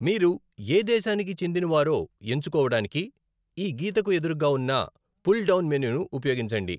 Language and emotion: Telugu, neutral